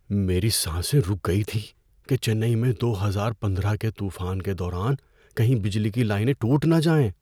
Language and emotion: Urdu, fearful